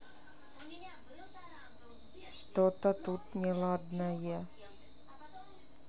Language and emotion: Russian, neutral